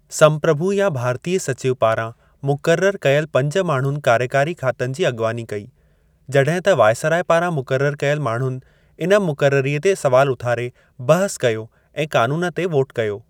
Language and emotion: Sindhi, neutral